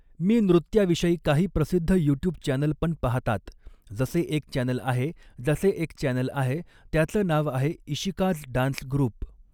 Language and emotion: Marathi, neutral